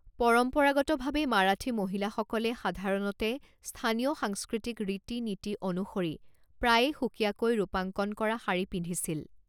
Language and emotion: Assamese, neutral